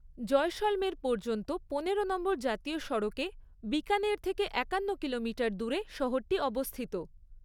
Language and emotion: Bengali, neutral